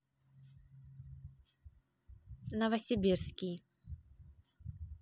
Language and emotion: Russian, neutral